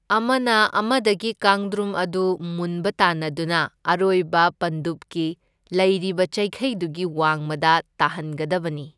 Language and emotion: Manipuri, neutral